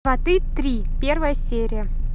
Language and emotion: Russian, neutral